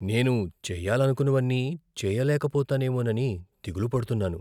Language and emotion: Telugu, fearful